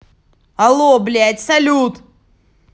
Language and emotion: Russian, angry